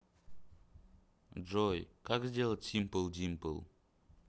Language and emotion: Russian, neutral